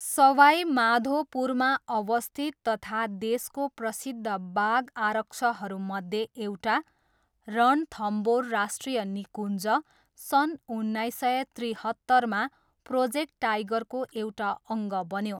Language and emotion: Nepali, neutral